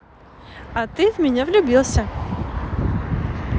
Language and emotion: Russian, positive